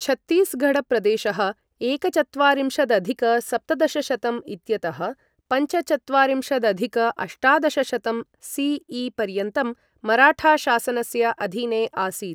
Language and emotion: Sanskrit, neutral